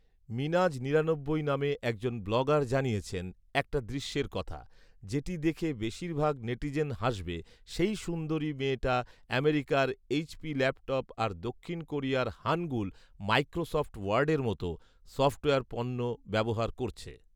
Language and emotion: Bengali, neutral